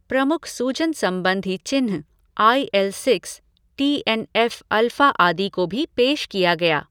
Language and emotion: Hindi, neutral